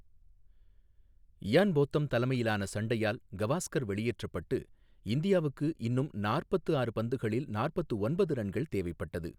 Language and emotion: Tamil, neutral